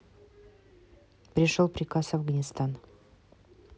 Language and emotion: Russian, neutral